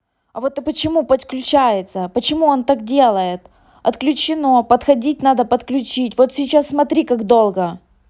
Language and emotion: Russian, angry